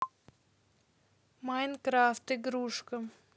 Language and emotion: Russian, neutral